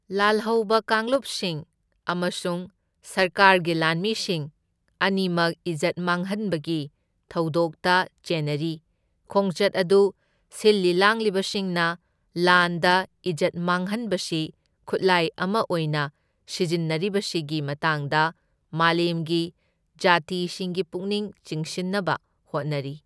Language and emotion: Manipuri, neutral